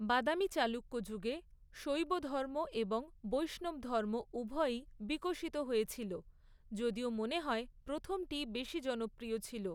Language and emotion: Bengali, neutral